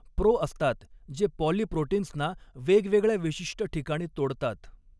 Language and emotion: Marathi, neutral